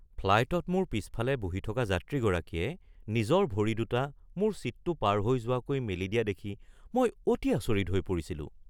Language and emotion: Assamese, surprised